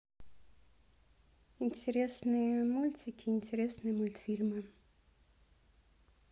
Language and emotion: Russian, neutral